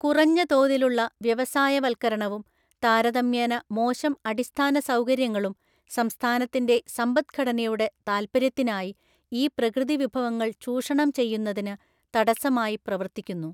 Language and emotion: Malayalam, neutral